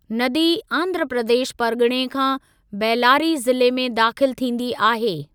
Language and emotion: Sindhi, neutral